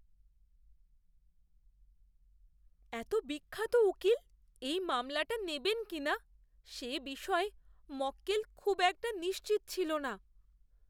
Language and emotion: Bengali, fearful